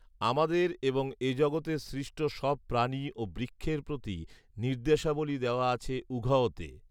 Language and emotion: Bengali, neutral